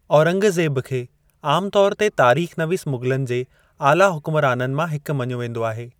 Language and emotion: Sindhi, neutral